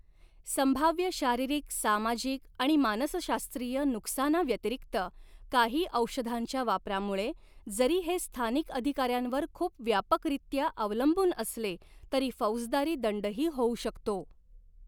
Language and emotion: Marathi, neutral